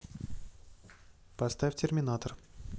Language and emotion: Russian, neutral